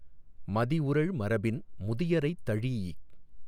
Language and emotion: Tamil, neutral